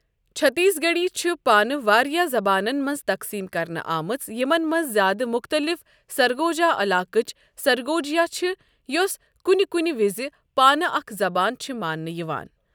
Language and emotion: Kashmiri, neutral